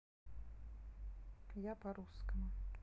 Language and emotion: Russian, neutral